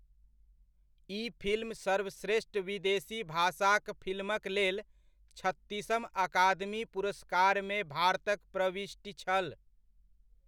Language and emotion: Maithili, neutral